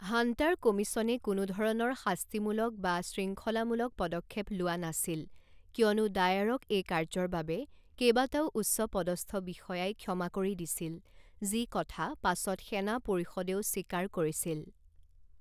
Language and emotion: Assamese, neutral